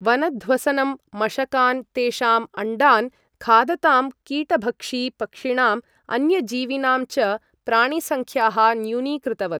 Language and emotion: Sanskrit, neutral